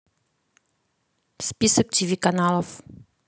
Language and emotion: Russian, neutral